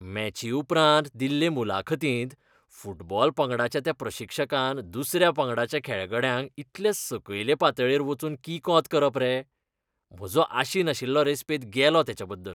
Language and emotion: Goan Konkani, disgusted